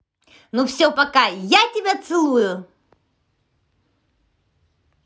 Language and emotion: Russian, positive